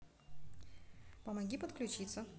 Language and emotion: Russian, neutral